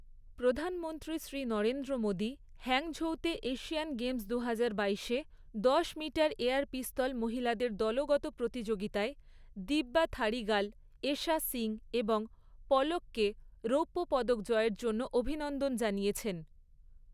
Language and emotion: Bengali, neutral